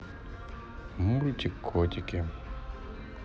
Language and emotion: Russian, neutral